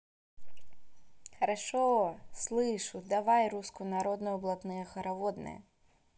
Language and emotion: Russian, positive